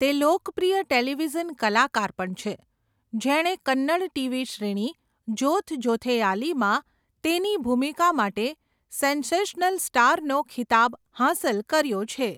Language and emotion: Gujarati, neutral